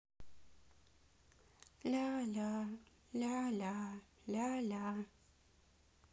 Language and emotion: Russian, sad